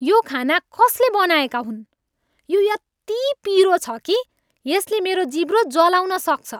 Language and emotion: Nepali, angry